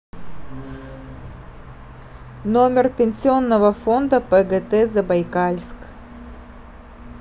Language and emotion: Russian, neutral